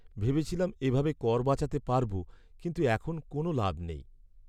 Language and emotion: Bengali, sad